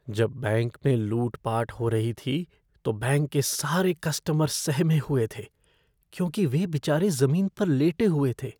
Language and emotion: Hindi, fearful